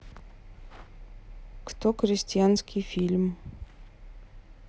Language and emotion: Russian, neutral